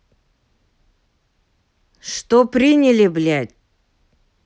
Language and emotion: Russian, angry